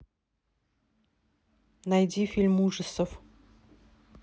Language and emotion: Russian, neutral